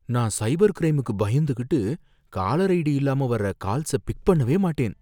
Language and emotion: Tamil, fearful